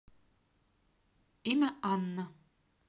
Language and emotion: Russian, neutral